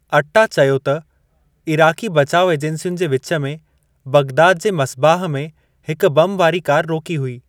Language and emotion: Sindhi, neutral